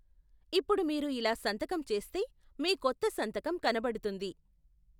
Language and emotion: Telugu, neutral